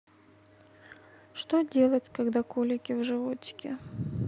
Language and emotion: Russian, sad